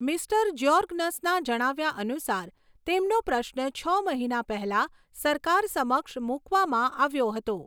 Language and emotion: Gujarati, neutral